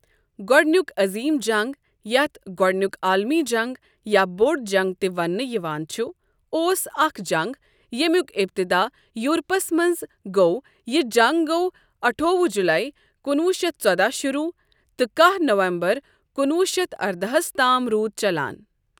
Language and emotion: Kashmiri, neutral